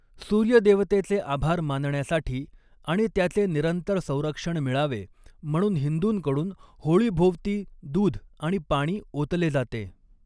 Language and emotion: Marathi, neutral